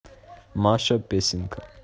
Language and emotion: Russian, neutral